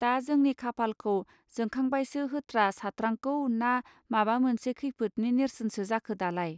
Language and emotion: Bodo, neutral